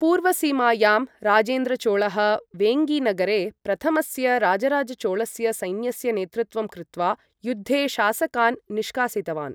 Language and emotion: Sanskrit, neutral